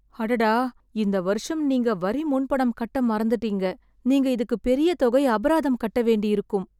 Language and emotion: Tamil, sad